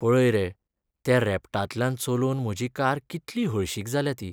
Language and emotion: Goan Konkani, sad